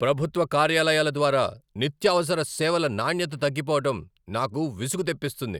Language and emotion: Telugu, angry